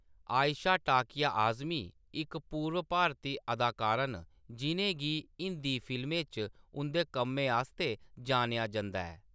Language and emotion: Dogri, neutral